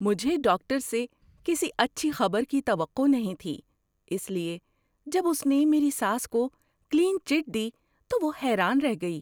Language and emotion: Urdu, surprised